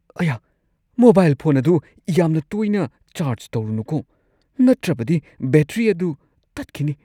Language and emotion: Manipuri, fearful